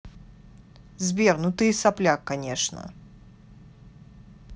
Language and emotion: Russian, angry